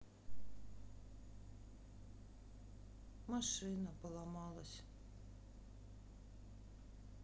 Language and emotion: Russian, sad